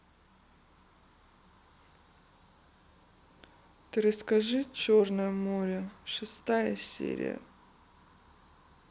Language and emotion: Russian, sad